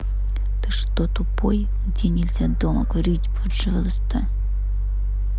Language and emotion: Russian, angry